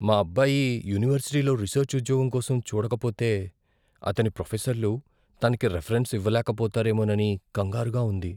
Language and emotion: Telugu, fearful